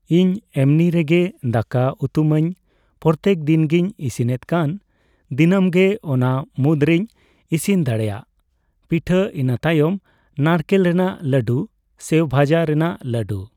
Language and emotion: Santali, neutral